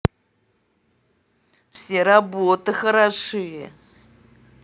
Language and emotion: Russian, angry